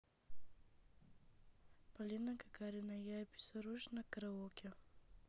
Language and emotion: Russian, neutral